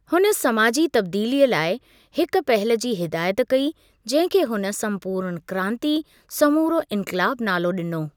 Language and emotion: Sindhi, neutral